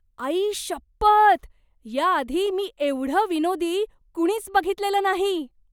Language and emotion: Marathi, surprised